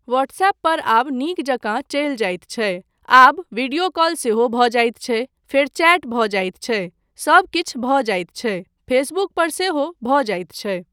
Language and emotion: Maithili, neutral